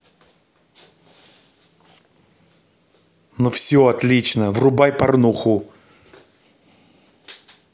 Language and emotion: Russian, neutral